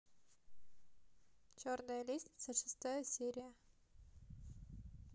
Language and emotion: Russian, neutral